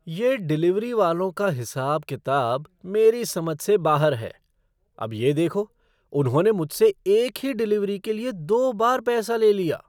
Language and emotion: Hindi, surprised